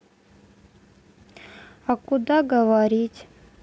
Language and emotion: Russian, sad